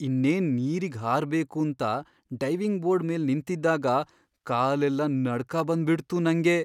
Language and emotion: Kannada, fearful